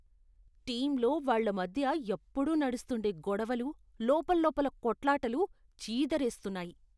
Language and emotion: Telugu, disgusted